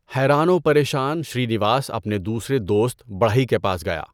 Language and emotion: Urdu, neutral